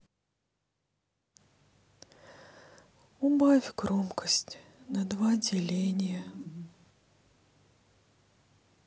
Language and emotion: Russian, sad